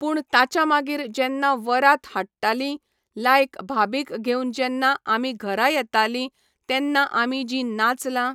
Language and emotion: Goan Konkani, neutral